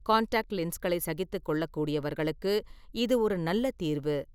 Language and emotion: Tamil, neutral